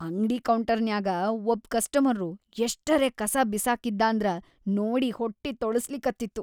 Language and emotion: Kannada, disgusted